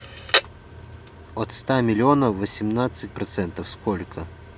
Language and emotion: Russian, neutral